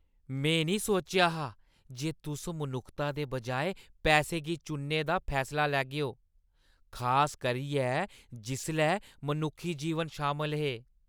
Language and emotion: Dogri, disgusted